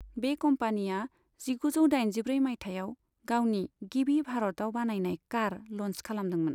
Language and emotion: Bodo, neutral